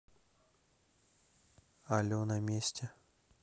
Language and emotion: Russian, neutral